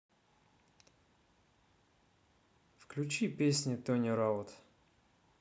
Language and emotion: Russian, neutral